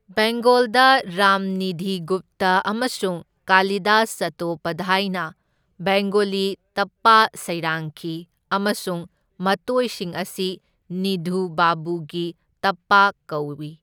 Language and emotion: Manipuri, neutral